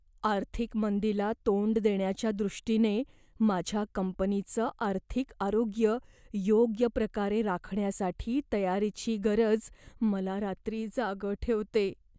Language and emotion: Marathi, fearful